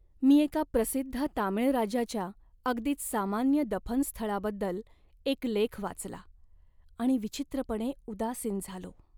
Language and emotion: Marathi, sad